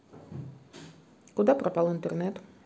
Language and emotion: Russian, neutral